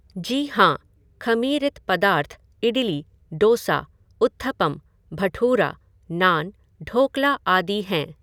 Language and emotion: Hindi, neutral